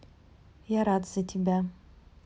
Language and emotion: Russian, neutral